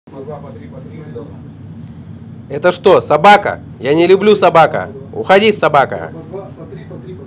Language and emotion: Russian, angry